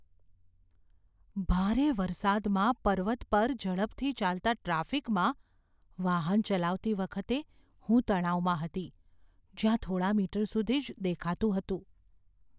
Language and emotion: Gujarati, fearful